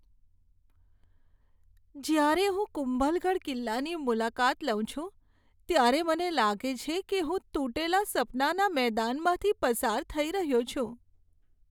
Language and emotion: Gujarati, sad